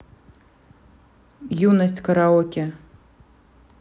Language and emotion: Russian, neutral